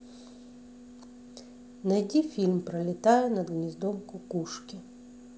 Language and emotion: Russian, neutral